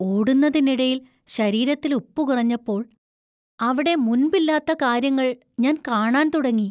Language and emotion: Malayalam, fearful